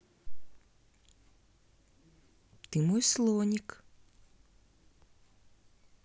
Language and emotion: Russian, positive